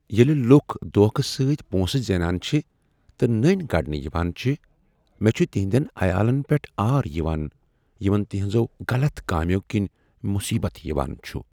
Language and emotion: Kashmiri, sad